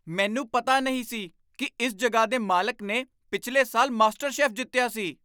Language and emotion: Punjabi, surprised